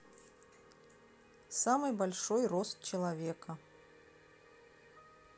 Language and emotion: Russian, neutral